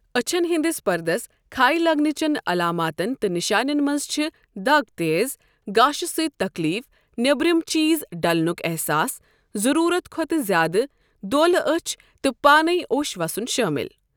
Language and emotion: Kashmiri, neutral